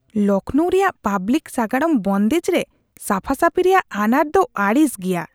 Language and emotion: Santali, disgusted